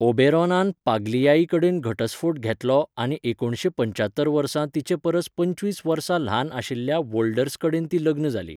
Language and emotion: Goan Konkani, neutral